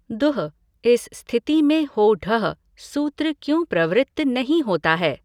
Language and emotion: Hindi, neutral